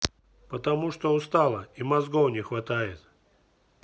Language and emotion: Russian, neutral